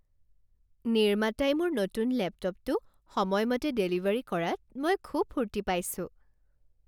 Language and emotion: Assamese, happy